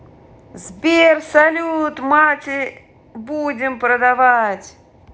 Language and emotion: Russian, positive